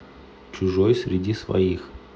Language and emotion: Russian, neutral